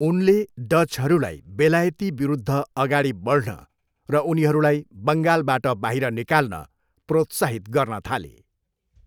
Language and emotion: Nepali, neutral